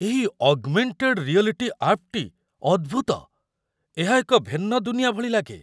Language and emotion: Odia, surprised